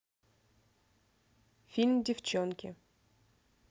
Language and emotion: Russian, neutral